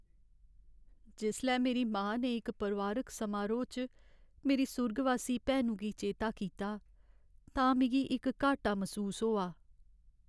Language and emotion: Dogri, sad